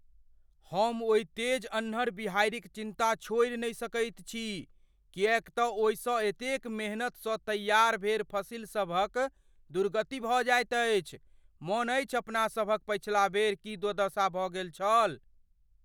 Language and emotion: Maithili, fearful